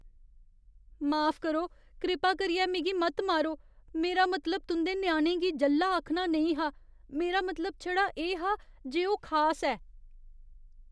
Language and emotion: Dogri, fearful